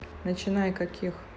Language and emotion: Russian, neutral